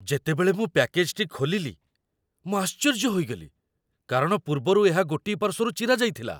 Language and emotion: Odia, surprised